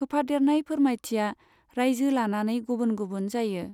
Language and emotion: Bodo, neutral